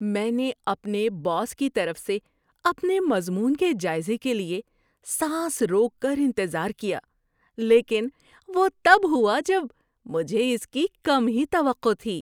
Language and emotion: Urdu, surprised